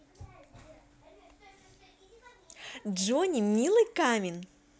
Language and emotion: Russian, positive